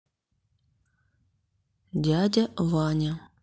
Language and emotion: Russian, neutral